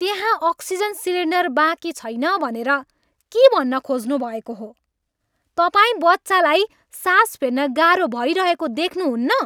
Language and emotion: Nepali, angry